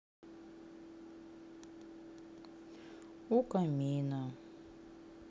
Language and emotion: Russian, sad